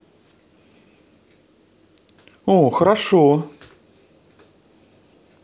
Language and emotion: Russian, positive